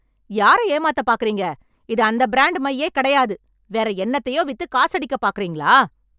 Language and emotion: Tamil, angry